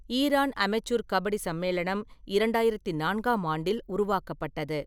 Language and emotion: Tamil, neutral